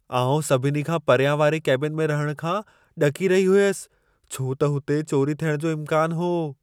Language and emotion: Sindhi, fearful